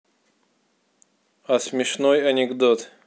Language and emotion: Russian, neutral